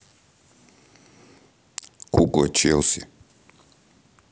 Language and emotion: Russian, neutral